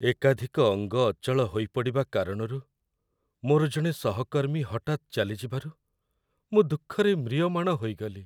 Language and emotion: Odia, sad